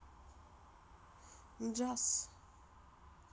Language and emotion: Russian, neutral